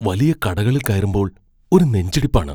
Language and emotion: Malayalam, fearful